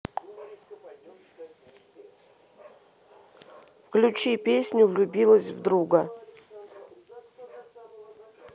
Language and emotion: Russian, neutral